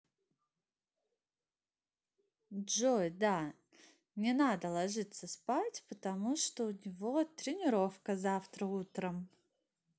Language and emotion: Russian, positive